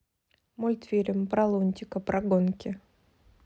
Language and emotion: Russian, neutral